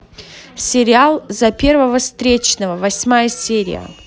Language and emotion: Russian, neutral